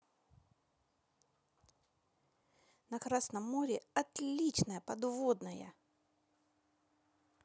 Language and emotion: Russian, positive